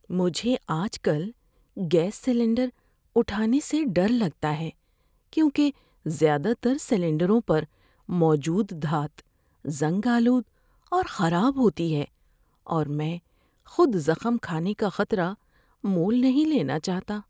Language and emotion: Urdu, fearful